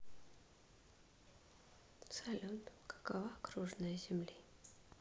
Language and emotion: Russian, neutral